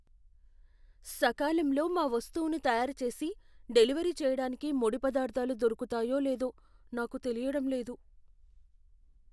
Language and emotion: Telugu, fearful